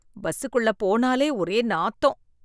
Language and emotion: Tamil, disgusted